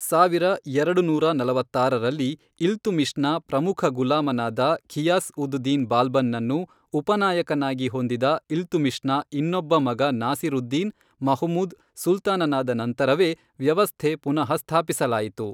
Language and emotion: Kannada, neutral